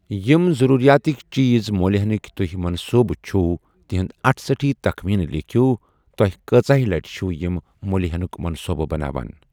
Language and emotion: Kashmiri, neutral